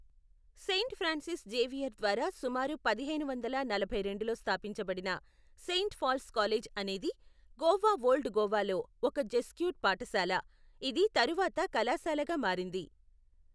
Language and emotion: Telugu, neutral